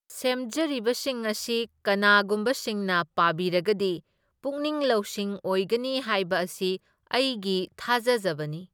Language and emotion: Manipuri, neutral